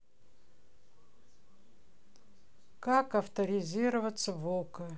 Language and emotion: Russian, neutral